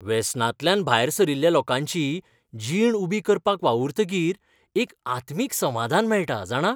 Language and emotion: Goan Konkani, happy